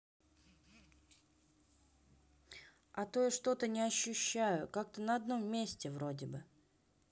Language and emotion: Russian, neutral